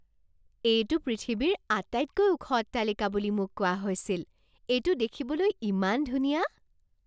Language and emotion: Assamese, surprised